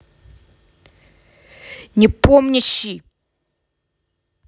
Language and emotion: Russian, angry